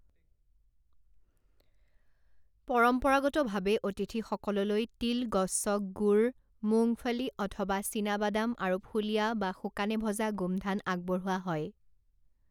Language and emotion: Assamese, neutral